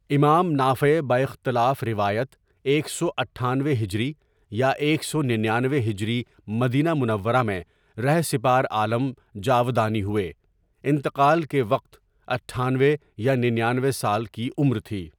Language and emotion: Urdu, neutral